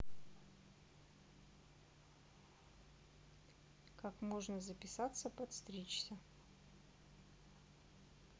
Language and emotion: Russian, neutral